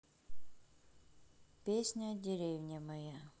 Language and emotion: Russian, neutral